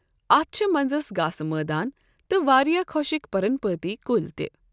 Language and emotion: Kashmiri, neutral